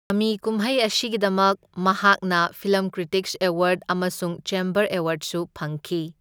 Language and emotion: Manipuri, neutral